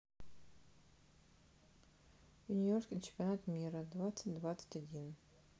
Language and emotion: Russian, neutral